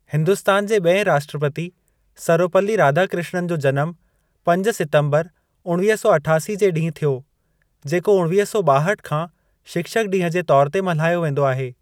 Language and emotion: Sindhi, neutral